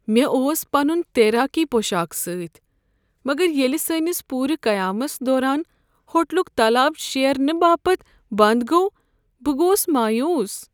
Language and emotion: Kashmiri, sad